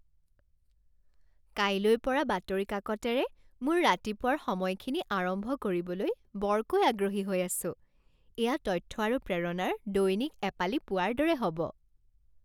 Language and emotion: Assamese, happy